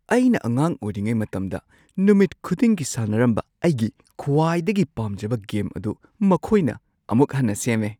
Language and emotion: Manipuri, surprised